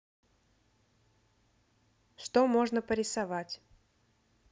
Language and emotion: Russian, neutral